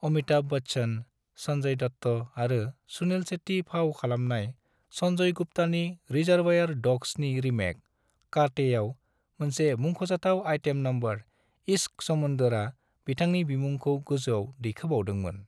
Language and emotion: Bodo, neutral